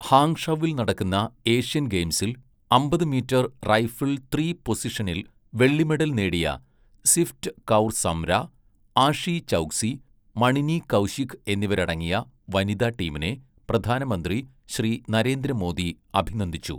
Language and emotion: Malayalam, neutral